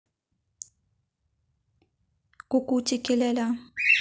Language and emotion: Russian, neutral